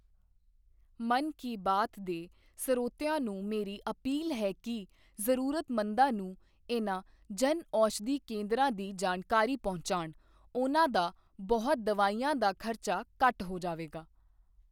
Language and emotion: Punjabi, neutral